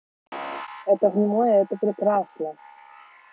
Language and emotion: Russian, neutral